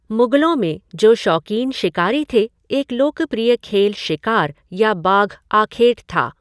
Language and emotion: Hindi, neutral